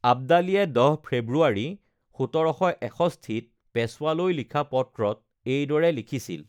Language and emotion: Assamese, neutral